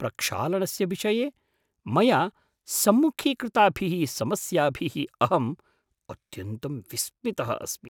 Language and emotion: Sanskrit, surprised